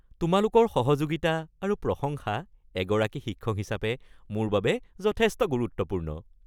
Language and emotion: Assamese, happy